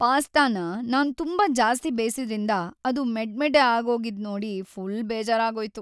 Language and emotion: Kannada, sad